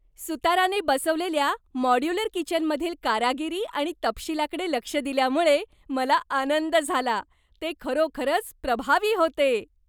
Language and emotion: Marathi, happy